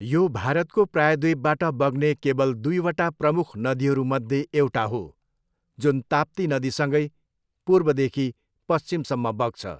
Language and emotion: Nepali, neutral